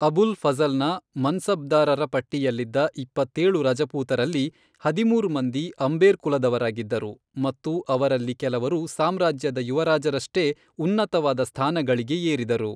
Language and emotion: Kannada, neutral